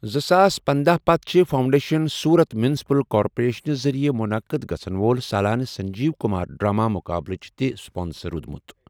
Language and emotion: Kashmiri, neutral